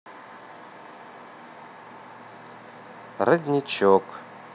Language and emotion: Russian, neutral